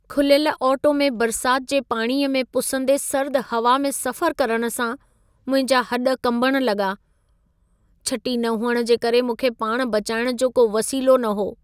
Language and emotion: Sindhi, sad